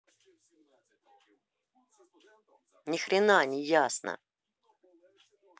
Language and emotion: Russian, angry